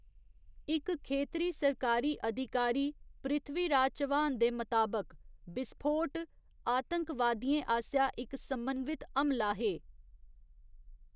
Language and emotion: Dogri, neutral